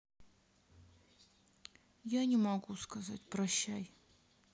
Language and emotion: Russian, sad